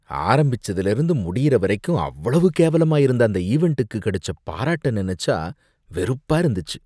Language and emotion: Tamil, disgusted